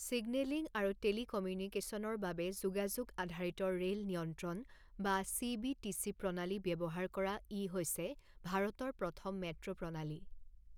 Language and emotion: Assamese, neutral